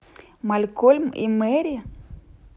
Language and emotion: Russian, neutral